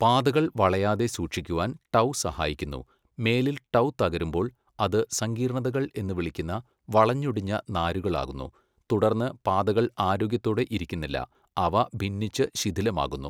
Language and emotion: Malayalam, neutral